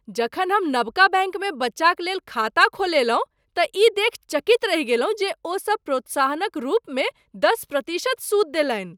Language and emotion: Maithili, surprised